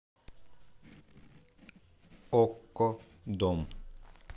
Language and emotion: Russian, neutral